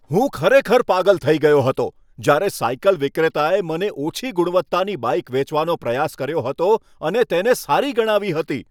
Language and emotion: Gujarati, angry